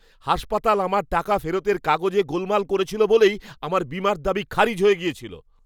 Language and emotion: Bengali, angry